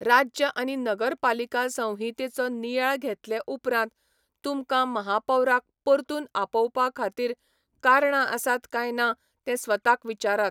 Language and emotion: Goan Konkani, neutral